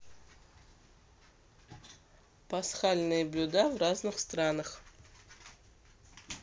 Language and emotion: Russian, neutral